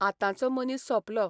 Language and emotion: Goan Konkani, neutral